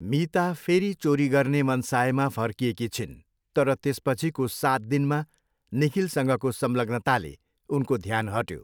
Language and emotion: Nepali, neutral